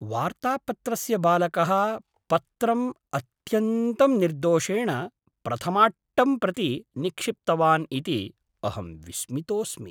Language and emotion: Sanskrit, surprised